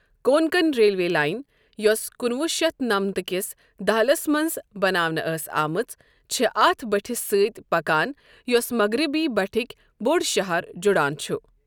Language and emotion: Kashmiri, neutral